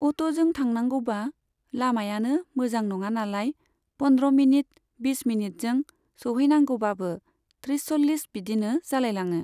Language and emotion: Bodo, neutral